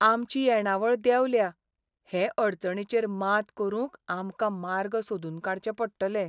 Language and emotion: Goan Konkani, sad